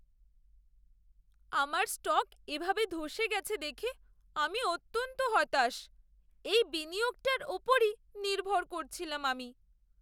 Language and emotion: Bengali, sad